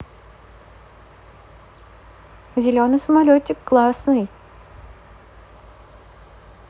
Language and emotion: Russian, positive